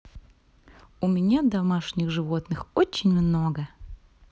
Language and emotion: Russian, positive